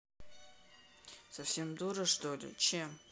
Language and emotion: Russian, neutral